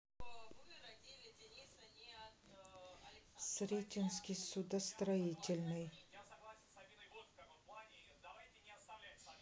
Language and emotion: Russian, neutral